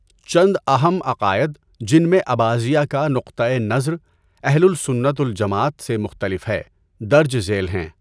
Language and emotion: Urdu, neutral